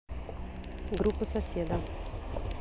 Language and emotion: Russian, neutral